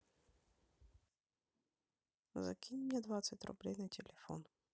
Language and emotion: Russian, neutral